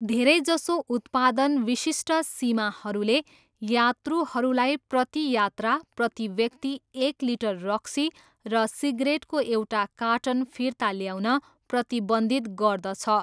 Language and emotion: Nepali, neutral